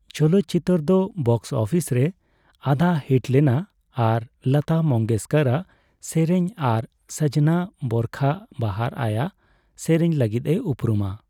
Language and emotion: Santali, neutral